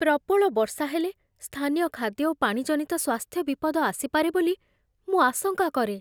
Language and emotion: Odia, fearful